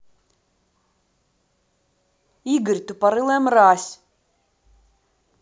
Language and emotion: Russian, angry